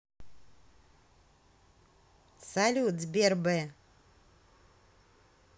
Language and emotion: Russian, positive